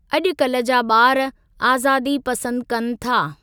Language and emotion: Sindhi, neutral